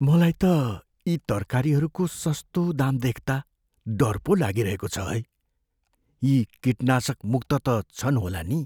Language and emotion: Nepali, fearful